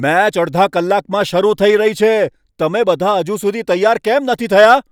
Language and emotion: Gujarati, angry